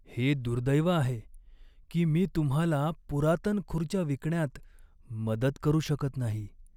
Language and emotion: Marathi, sad